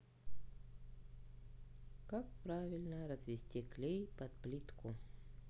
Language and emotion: Russian, neutral